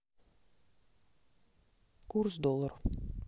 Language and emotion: Russian, neutral